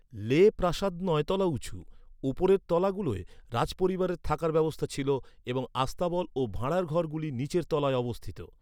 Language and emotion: Bengali, neutral